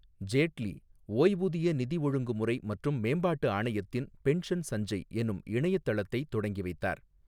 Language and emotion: Tamil, neutral